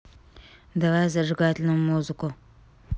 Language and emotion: Russian, neutral